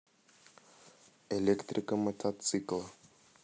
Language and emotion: Russian, neutral